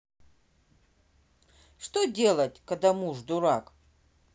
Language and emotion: Russian, neutral